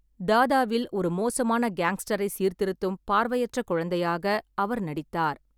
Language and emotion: Tamil, neutral